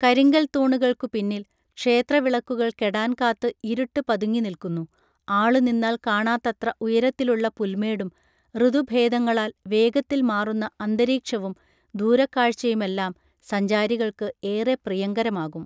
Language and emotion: Malayalam, neutral